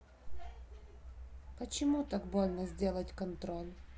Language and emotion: Russian, sad